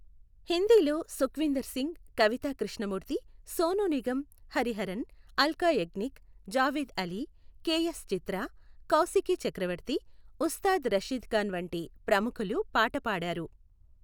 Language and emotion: Telugu, neutral